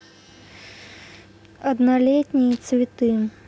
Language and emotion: Russian, neutral